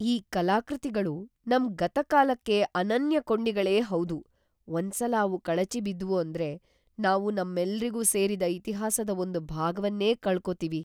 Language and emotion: Kannada, fearful